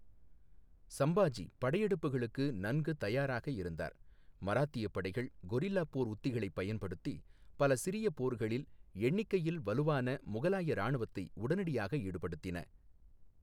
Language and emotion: Tamil, neutral